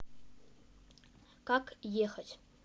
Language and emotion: Russian, neutral